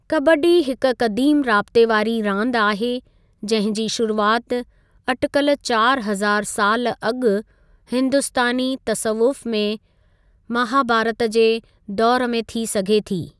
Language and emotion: Sindhi, neutral